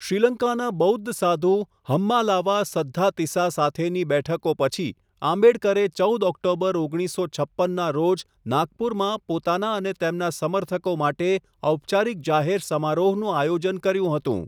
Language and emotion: Gujarati, neutral